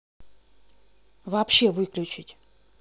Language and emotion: Russian, angry